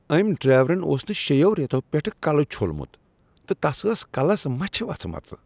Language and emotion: Kashmiri, disgusted